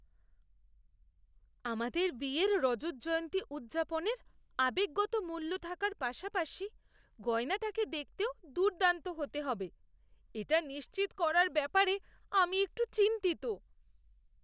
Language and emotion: Bengali, fearful